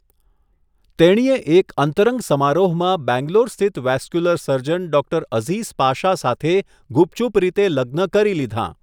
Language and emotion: Gujarati, neutral